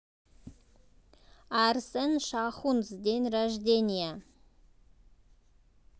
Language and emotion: Russian, positive